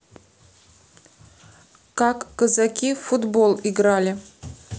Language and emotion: Russian, neutral